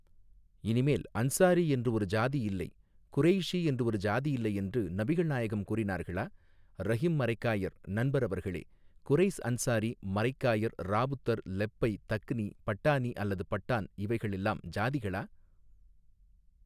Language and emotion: Tamil, neutral